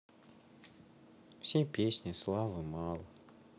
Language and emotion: Russian, sad